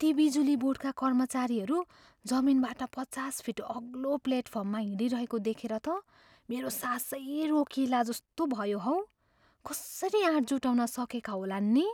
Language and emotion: Nepali, fearful